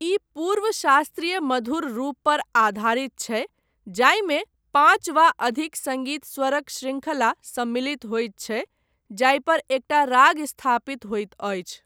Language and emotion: Maithili, neutral